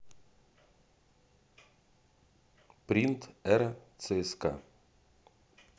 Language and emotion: Russian, neutral